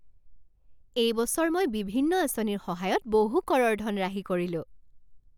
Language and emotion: Assamese, happy